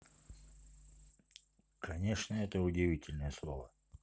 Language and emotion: Russian, neutral